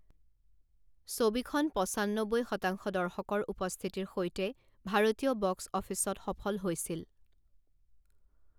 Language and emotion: Assamese, neutral